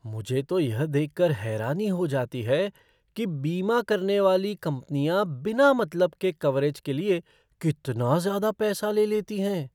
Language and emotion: Hindi, surprised